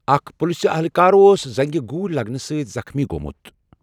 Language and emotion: Kashmiri, neutral